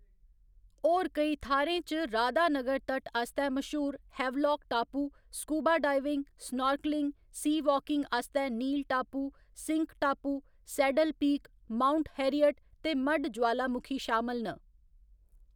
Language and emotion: Dogri, neutral